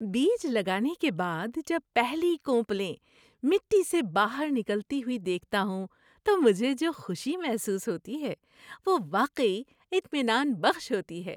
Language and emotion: Urdu, happy